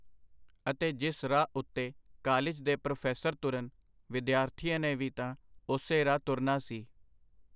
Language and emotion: Punjabi, neutral